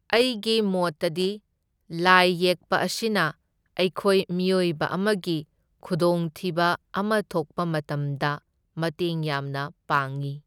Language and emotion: Manipuri, neutral